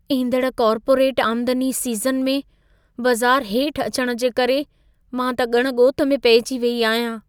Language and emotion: Sindhi, fearful